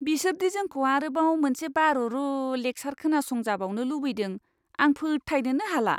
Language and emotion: Bodo, disgusted